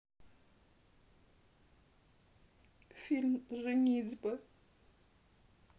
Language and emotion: Russian, sad